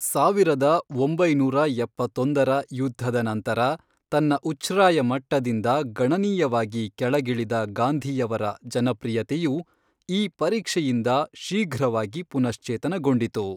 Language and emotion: Kannada, neutral